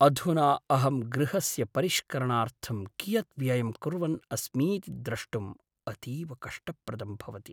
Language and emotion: Sanskrit, sad